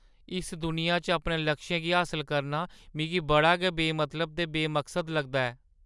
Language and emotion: Dogri, sad